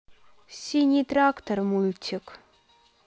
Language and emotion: Russian, sad